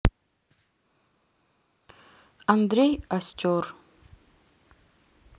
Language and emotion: Russian, neutral